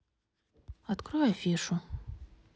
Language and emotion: Russian, neutral